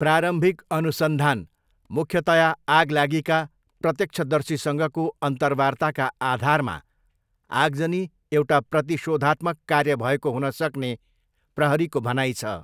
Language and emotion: Nepali, neutral